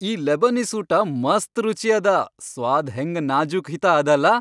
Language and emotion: Kannada, happy